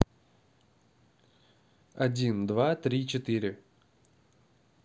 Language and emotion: Russian, neutral